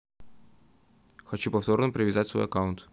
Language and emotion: Russian, neutral